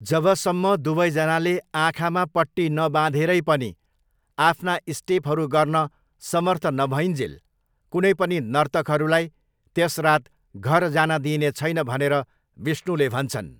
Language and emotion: Nepali, neutral